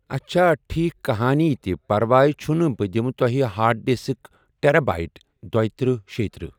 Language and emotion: Kashmiri, neutral